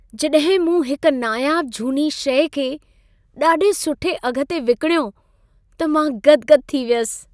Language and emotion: Sindhi, happy